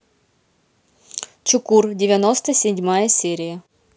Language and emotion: Russian, neutral